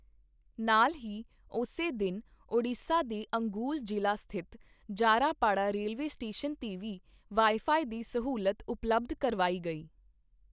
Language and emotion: Punjabi, neutral